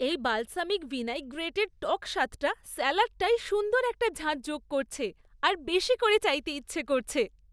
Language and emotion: Bengali, happy